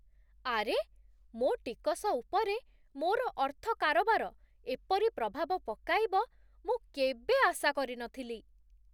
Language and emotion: Odia, surprised